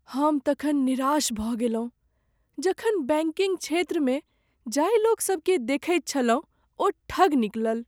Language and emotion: Maithili, sad